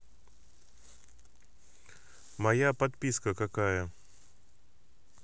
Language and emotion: Russian, neutral